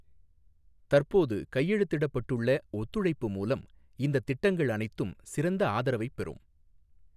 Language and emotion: Tamil, neutral